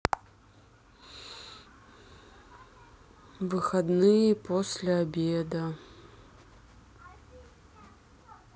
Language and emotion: Russian, sad